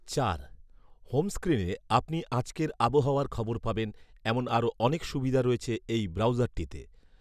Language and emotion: Bengali, neutral